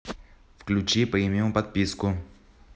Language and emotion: Russian, neutral